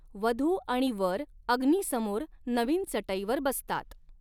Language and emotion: Marathi, neutral